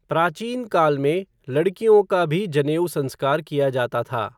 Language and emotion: Hindi, neutral